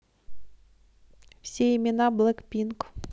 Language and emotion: Russian, neutral